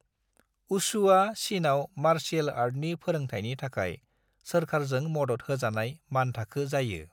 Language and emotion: Bodo, neutral